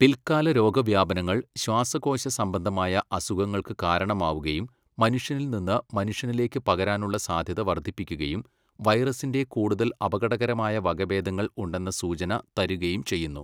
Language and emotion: Malayalam, neutral